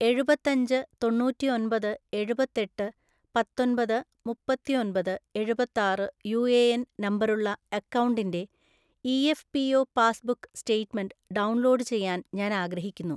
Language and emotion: Malayalam, neutral